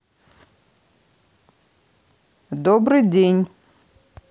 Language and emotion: Russian, neutral